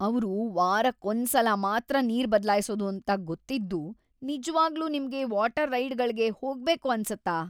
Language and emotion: Kannada, disgusted